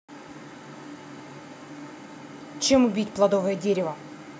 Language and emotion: Russian, angry